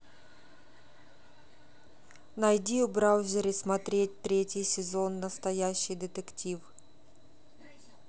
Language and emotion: Russian, neutral